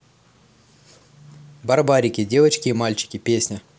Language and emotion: Russian, positive